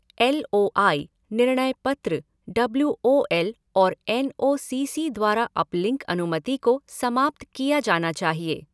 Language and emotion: Hindi, neutral